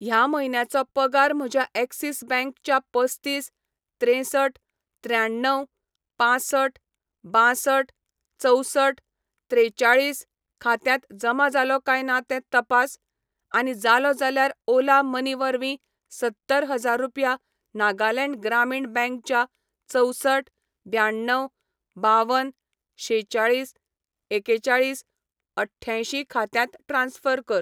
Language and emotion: Goan Konkani, neutral